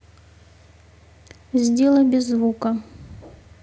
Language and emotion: Russian, neutral